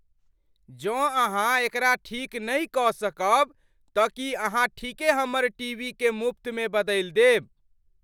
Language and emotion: Maithili, surprised